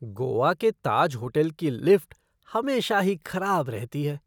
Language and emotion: Hindi, disgusted